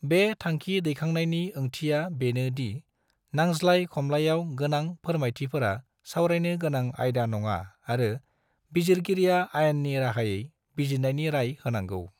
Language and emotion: Bodo, neutral